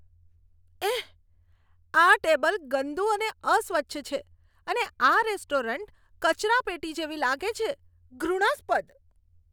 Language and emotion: Gujarati, disgusted